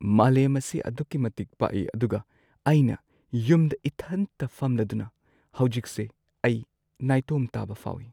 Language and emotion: Manipuri, sad